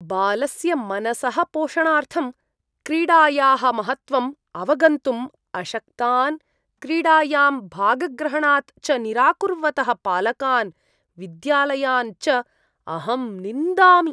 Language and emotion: Sanskrit, disgusted